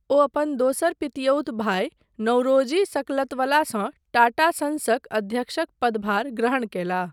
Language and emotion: Maithili, neutral